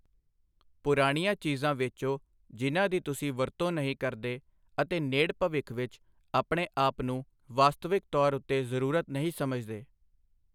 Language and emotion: Punjabi, neutral